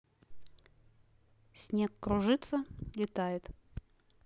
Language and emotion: Russian, neutral